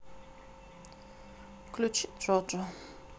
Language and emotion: Russian, neutral